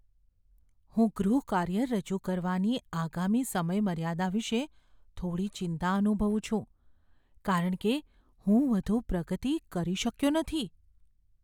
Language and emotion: Gujarati, fearful